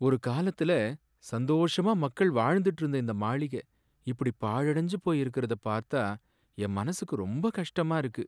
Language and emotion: Tamil, sad